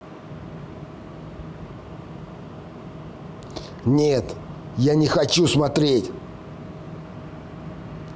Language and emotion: Russian, angry